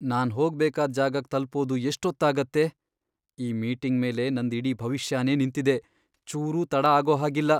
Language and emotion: Kannada, fearful